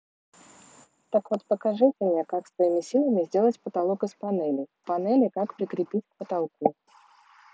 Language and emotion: Russian, neutral